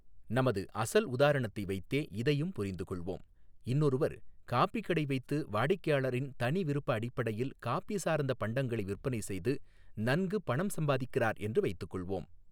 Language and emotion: Tamil, neutral